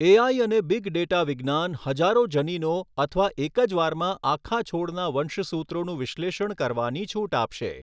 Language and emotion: Gujarati, neutral